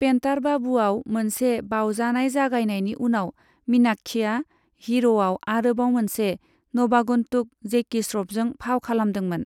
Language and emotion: Bodo, neutral